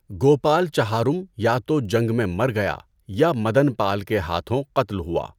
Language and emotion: Urdu, neutral